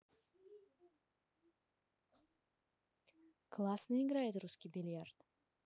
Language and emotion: Russian, neutral